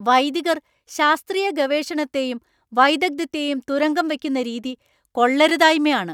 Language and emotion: Malayalam, angry